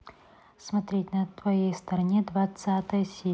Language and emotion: Russian, neutral